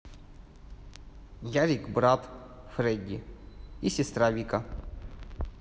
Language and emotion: Russian, neutral